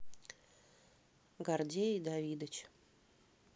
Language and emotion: Russian, neutral